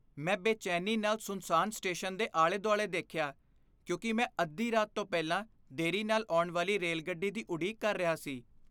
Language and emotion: Punjabi, fearful